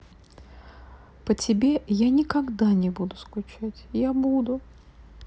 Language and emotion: Russian, sad